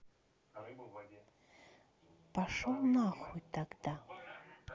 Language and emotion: Russian, angry